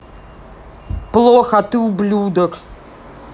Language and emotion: Russian, angry